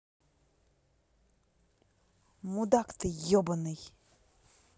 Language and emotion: Russian, angry